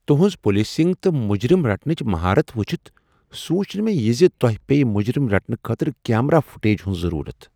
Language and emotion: Kashmiri, surprised